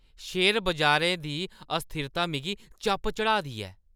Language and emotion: Dogri, angry